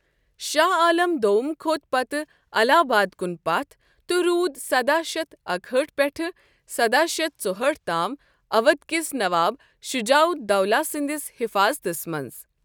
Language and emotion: Kashmiri, neutral